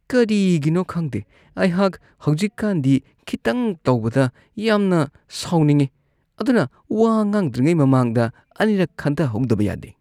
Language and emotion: Manipuri, disgusted